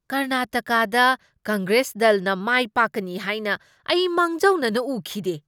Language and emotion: Manipuri, surprised